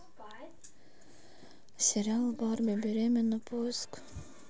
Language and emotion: Russian, sad